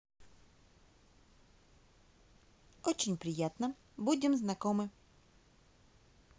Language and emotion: Russian, positive